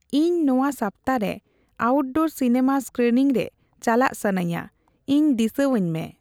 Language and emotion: Santali, neutral